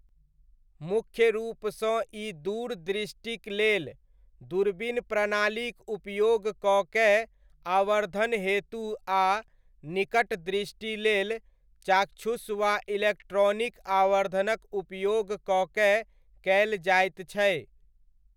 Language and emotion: Maithili, neutral